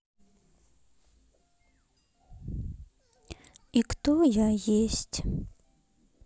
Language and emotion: Russian, sad